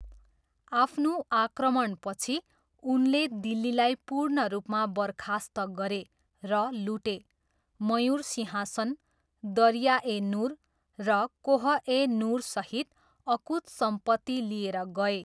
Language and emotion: Nepali, neutral